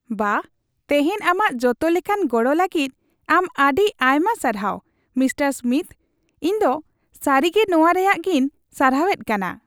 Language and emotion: Santali, happy